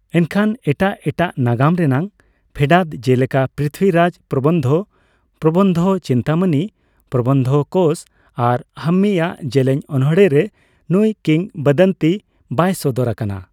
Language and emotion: Santali, neutral